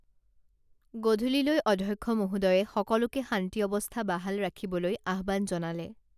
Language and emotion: Assamese, neutral